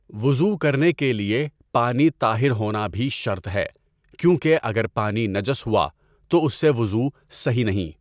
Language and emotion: Urdu, neutral